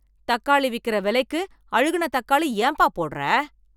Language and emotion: Tamil, angry